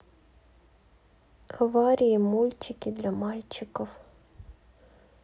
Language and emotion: Russian, neutral